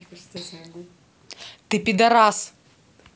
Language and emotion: Russian, angry